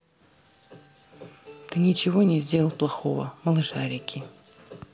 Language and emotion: Russian, neutral